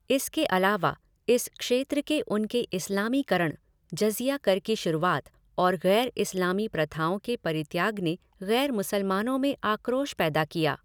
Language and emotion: Hindi, neutral